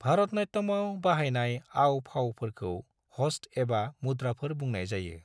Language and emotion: Bodo, neutral